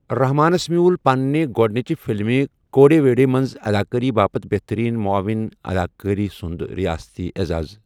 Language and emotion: Kashmiri, neutral